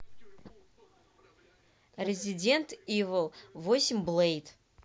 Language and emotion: Russian, neutral